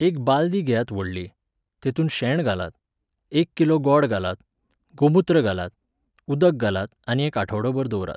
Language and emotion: Goan Konkani, neutral